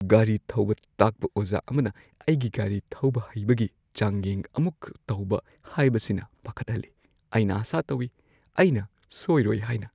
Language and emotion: Manipuri, fearful